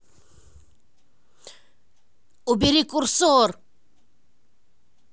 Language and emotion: Russian, angry